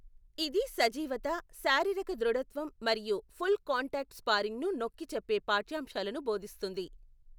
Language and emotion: Telugu, neutral